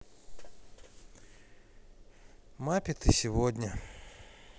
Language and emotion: Russian, sad